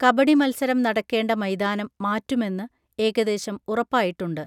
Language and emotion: Malayalam, neutral